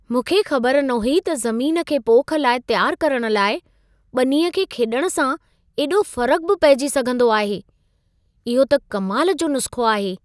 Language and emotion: Sindhi, surprised